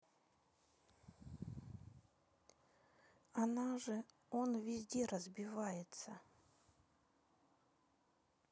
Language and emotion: Russian, sad